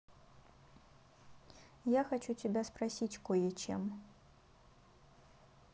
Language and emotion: Russian, neutral